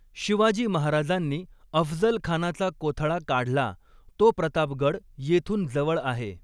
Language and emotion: Marathi, neutral